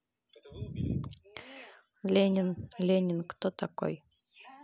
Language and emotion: Russian, neutral